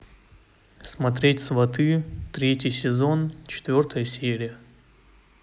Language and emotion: Russian, neutral